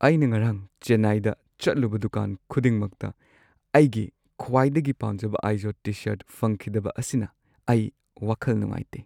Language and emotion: Manipuri, sad